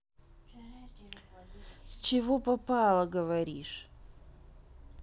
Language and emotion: Russian, neutral